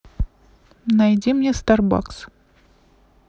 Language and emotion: Russian, neutral